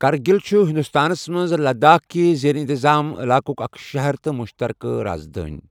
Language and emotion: Kashmiri, neutral